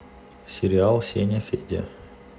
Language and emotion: Russian, neutral